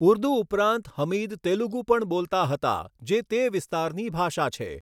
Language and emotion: Gujarati, neutral